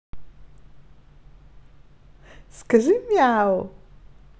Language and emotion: Russian, positive